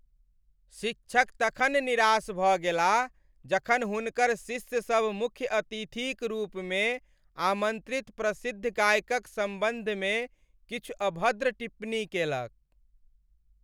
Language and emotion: Maithili, sad